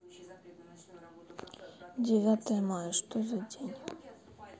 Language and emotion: Russian, sad